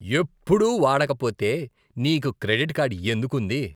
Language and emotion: Telugu, disgusted